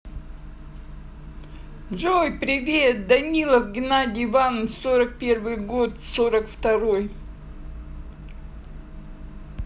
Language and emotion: Russian, positive